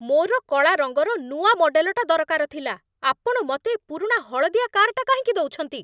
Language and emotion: Odia, angry